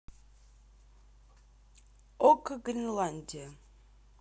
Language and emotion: Russian, neutral